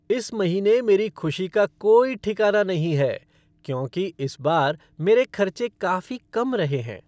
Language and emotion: Hindi, happy